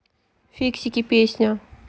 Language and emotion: Russian, neutral